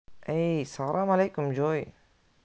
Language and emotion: Russian, positive